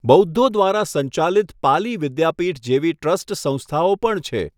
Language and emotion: Gujarati, neutral